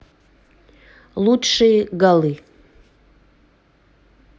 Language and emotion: Russian, neutral